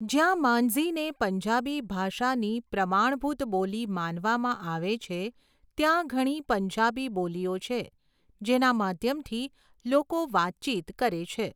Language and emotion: Gujarati, neutral